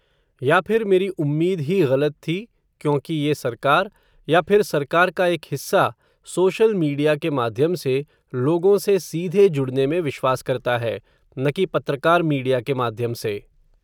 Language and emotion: Hindi, neutral